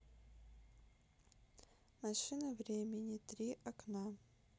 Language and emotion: Russian, neutral